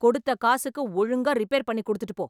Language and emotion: Tamil, angry